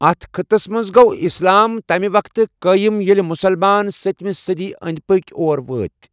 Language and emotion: Kashmiri, neutral